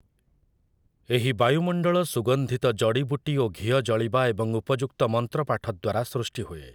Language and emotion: Odia, neutral